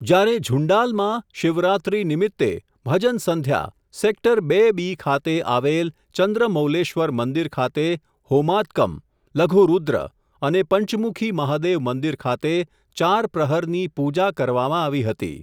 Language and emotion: Gujarati, neutral